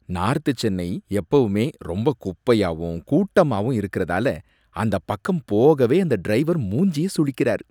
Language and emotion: Tamil, disgusted